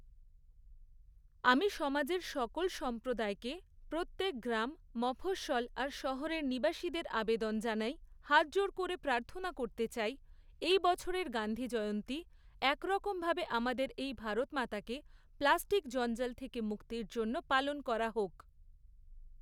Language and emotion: Bengali, neutral